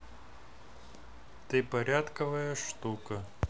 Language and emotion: Russian, neutral